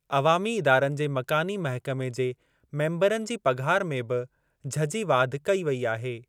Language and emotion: Sindhi, neutral